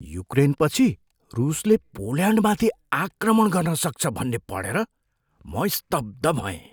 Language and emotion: Nepali, surprised